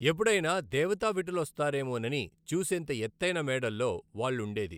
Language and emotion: Telugu, neutral